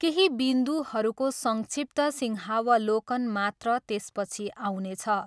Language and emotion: Nepali, neutral